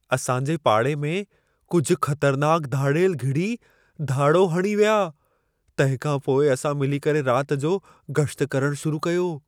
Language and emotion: Sindhi, fearful